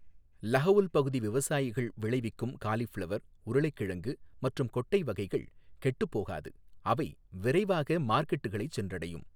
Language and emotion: Tamil, neutral